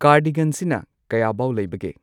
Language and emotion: Manipuri, neutral